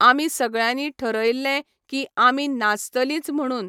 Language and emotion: Goan Konkani, neutral